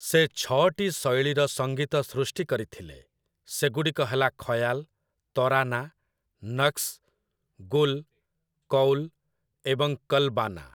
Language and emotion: Odia, neutral